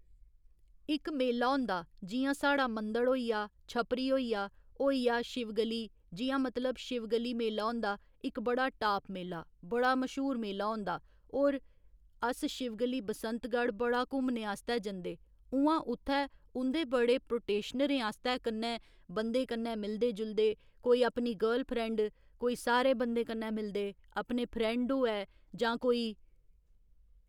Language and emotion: Dogri, neutral